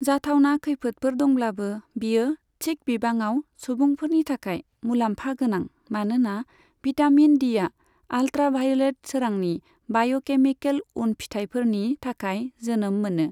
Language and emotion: Bodo, neutral